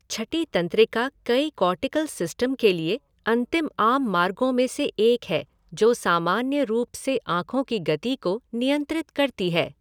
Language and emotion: Hindi, neutral